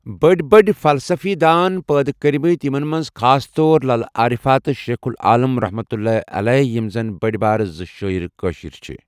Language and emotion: Kashmiri, neutral